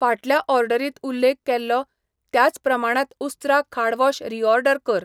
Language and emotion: Goan Konkani, neutral